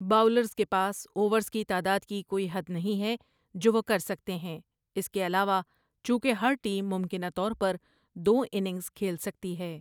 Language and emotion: Urdu, neutral